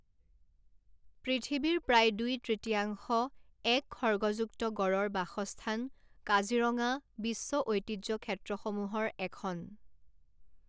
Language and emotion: Assamese, neutral